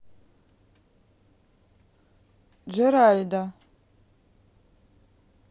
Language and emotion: Russian, neutral